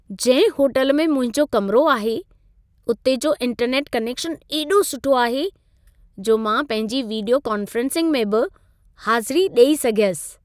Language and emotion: Sindhi, happy